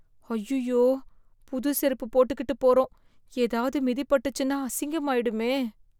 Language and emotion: Tamil, fearful